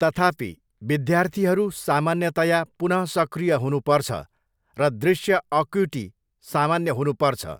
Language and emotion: Nepali, neutral